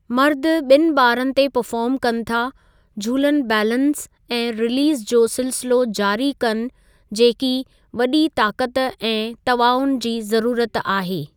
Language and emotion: Sindhi, neutral